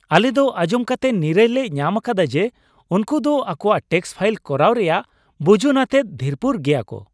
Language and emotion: Santali, happy